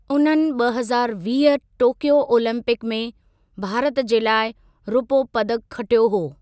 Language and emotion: Sindhi, neutral